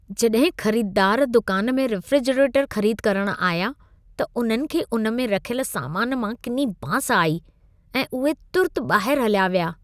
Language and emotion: Sindhi, disgusted